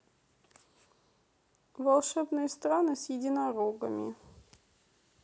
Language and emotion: Russian, neutral